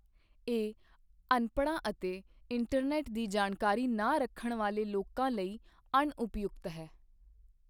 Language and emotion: Punjabi, neutral